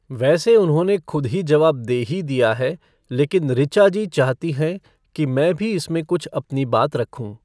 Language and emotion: Hindi, neutral